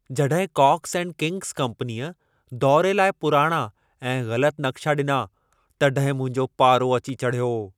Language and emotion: Sindhi, angry